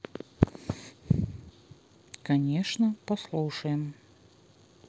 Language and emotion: Russian, neutral